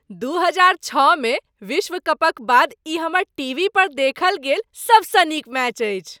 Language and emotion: Maithili, happy